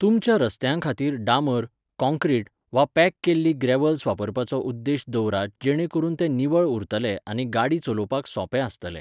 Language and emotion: Goan Konkani, neutral